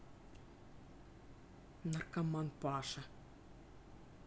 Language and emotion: Russian, neutral